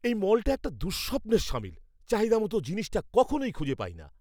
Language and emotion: Bengali, angry